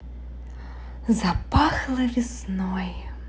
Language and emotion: Russian, positive